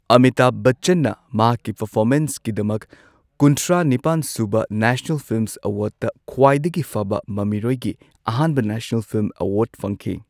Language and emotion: Manipuri, neutral